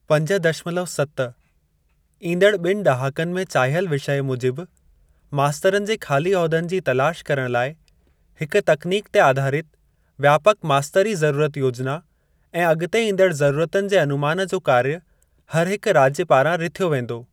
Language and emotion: Sindhi, neutral